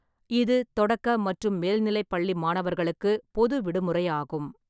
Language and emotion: Tamil, neutral